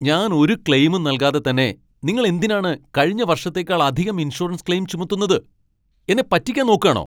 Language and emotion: Malayalam, angry